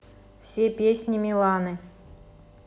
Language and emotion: Russian, neutral